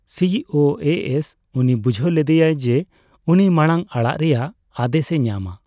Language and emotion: Santali, neutral